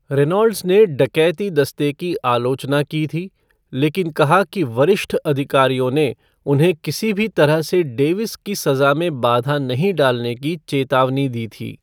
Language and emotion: Hindi, neutral